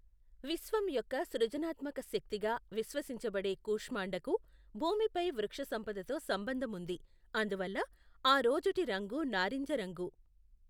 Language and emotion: Telugu, neutral